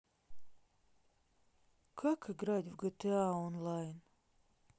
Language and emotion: Russian, sad